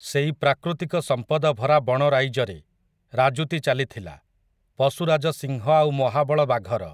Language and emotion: Odia, neutral